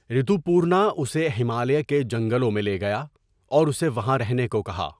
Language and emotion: Urdu, neutral